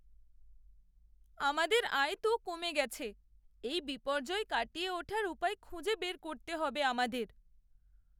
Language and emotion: Bengali, sad